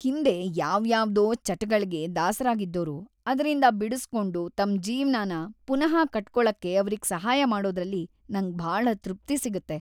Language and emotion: Kannada, happy